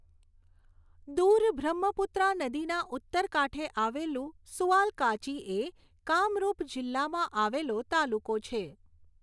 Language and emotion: Gujarati, neutral